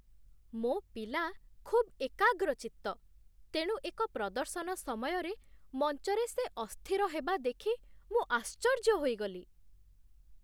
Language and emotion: Odia, surprised